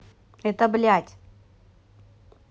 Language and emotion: Russian, angry